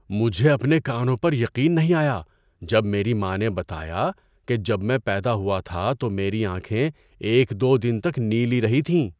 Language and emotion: Urdu, surprised